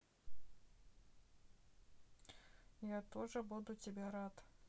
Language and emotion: Russian, neutral